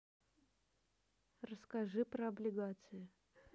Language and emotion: Russian, neutral